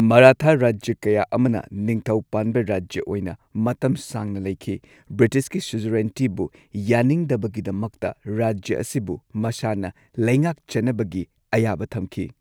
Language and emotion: Manipuri, neutral